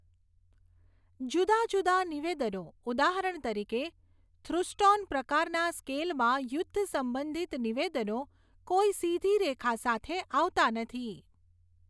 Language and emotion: Gujarati, neutral